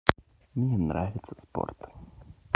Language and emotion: Russian, positive